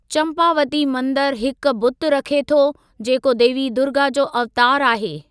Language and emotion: Sindhi, neutral